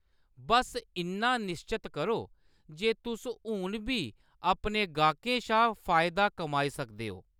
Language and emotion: Dogri, neutral